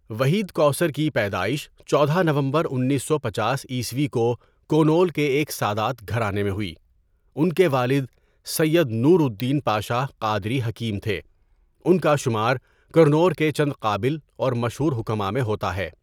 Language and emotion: Urdu, neutral